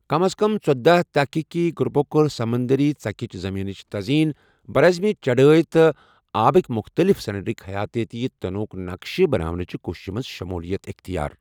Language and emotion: Kashmiri, neutral